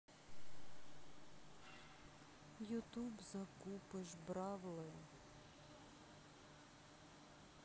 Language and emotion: Russian, sad